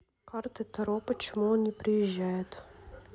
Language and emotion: Russian, neutral